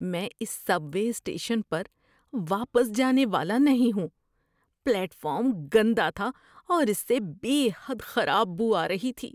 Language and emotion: Urdu, disgusted